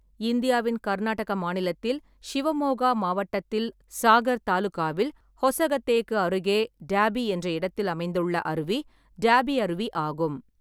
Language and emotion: Tamil, neutral